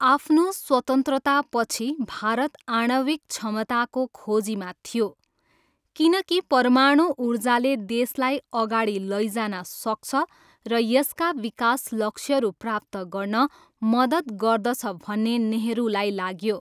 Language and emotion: Nepali, neutral